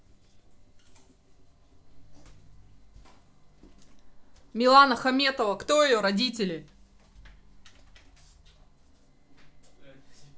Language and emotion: Russian, neutral